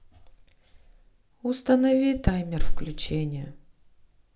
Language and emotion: Russian, sad